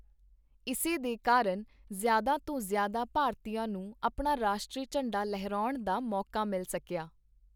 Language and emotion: Punjabi, neutral